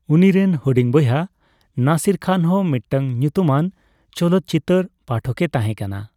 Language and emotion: Santali, neutral